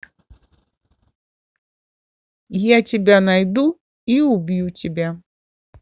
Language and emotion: Russian, neutral